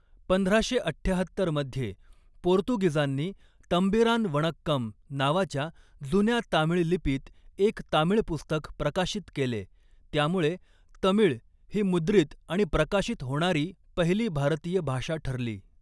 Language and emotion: Marathi, neutral